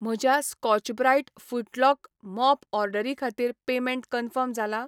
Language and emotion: Goan Konkani, neutral